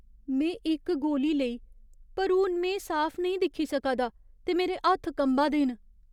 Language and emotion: Dogri, fearful